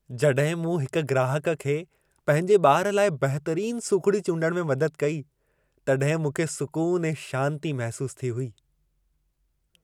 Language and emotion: Sindhi, happy